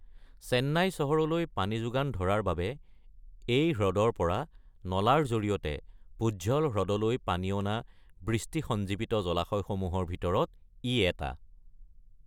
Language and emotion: Assamese, neutral